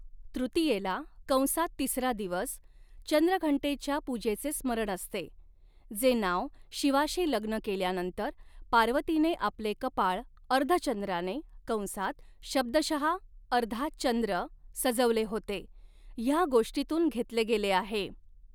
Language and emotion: Marathi, neutral